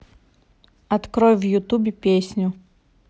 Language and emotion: Russian, neutral